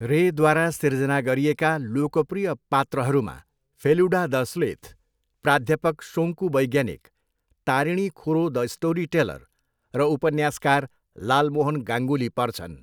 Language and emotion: Nepali, neutral